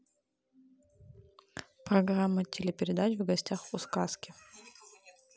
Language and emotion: Russian, neutral